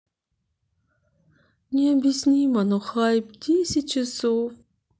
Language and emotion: Russian, sad